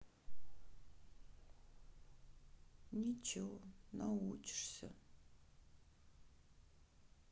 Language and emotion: Russian, sad